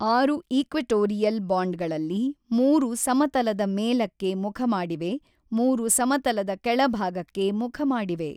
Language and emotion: Kannada, neutral